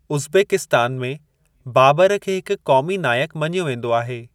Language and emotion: Sindhi, neutral